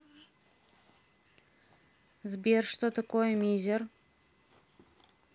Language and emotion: Russian, neutral